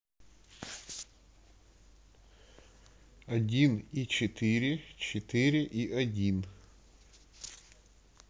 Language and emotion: Russian, neutral